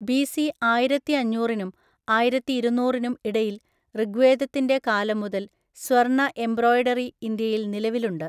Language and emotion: Malayalam, neutral